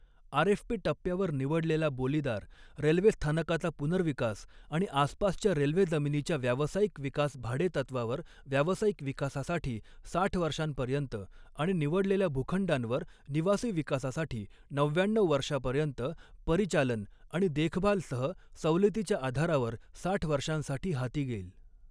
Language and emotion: Marathi, neutral